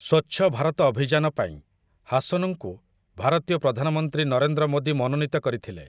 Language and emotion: Odia, neutral